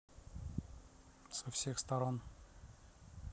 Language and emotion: Russian, neutral